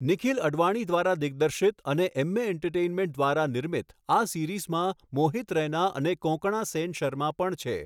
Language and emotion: Gujarati, neutral